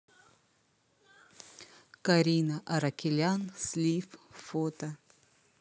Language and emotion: Russian, neutral